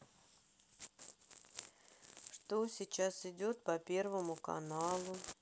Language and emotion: Russian, sad